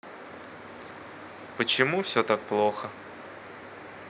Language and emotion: Russian, sad